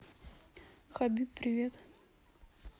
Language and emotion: Russian, neutral